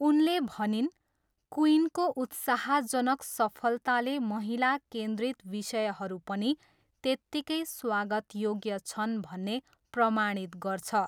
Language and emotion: Nepali, neutral